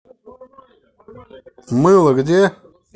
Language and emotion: Russian, angry